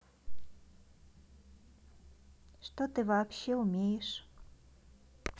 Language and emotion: Russian, neutral